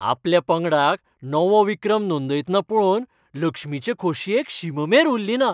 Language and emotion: Goan Konkani, happy